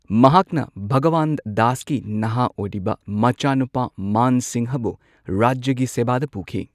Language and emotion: Manipuri, neutral